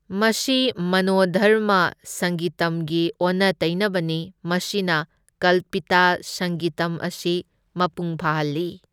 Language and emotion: Manipuri, neutral